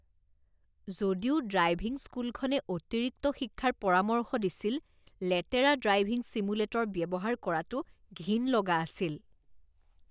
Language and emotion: Assamese, disgusted